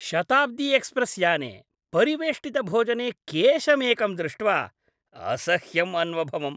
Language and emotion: Sanskrit, disgusted